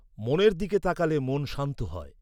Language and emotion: Bengali, neutral